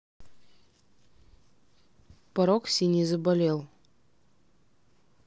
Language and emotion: Russian, neutral